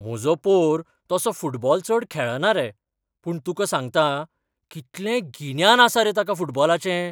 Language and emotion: Goan Konkani, surprised